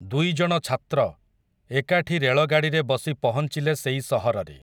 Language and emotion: Odia, neutral